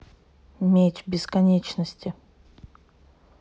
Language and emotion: Russian, neutral